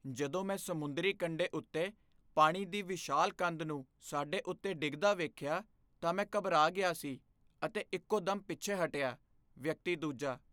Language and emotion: Punjabi, fearful